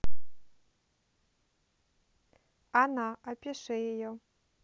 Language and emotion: Russian, neutral